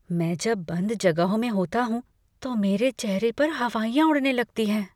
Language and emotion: Hindi, fearful